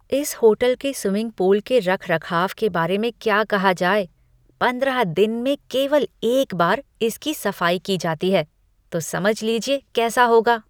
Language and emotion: Hindi, disgusted